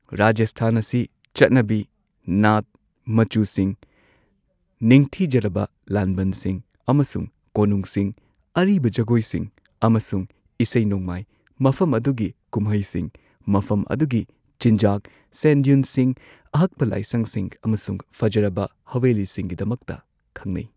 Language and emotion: Manipuri, neutral